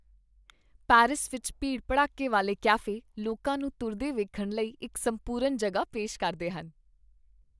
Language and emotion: Punjabi, happy